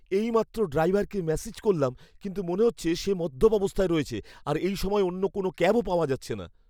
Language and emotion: Bengali, fearful